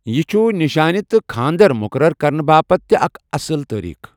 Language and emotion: Kashmiri, neutral